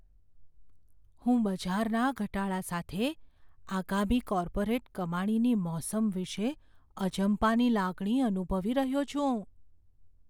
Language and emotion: Gujarati, fearful